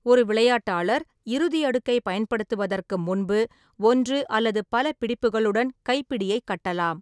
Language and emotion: Tamil, neutral